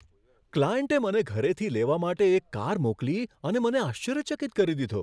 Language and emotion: Gujarati, surprised